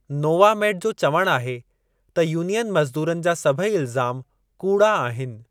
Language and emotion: Sindhi, neutral